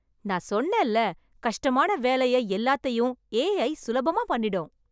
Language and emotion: Tamil, happy